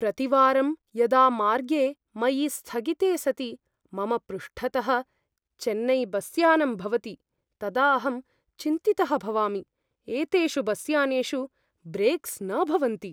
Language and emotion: Sanskrit, fearful